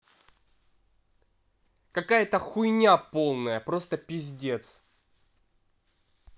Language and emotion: Russian, angry